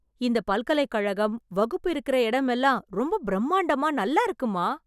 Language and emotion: Tamil, happy